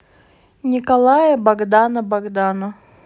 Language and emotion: Russian, neutral